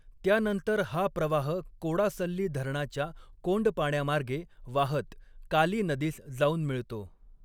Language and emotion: Marathi, neutral